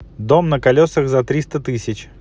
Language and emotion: Russian, neutral